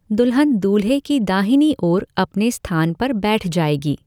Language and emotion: Hindi, neutral